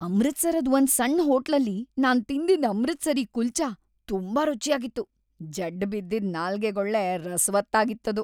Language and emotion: Kannada, happy